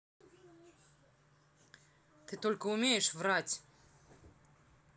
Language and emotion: Russian, angry